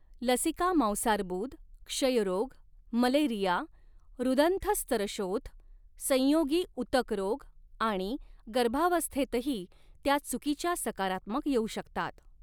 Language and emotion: Marathi, neutral